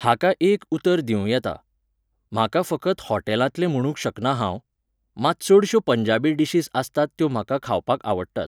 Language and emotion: Goan Konkani, neutral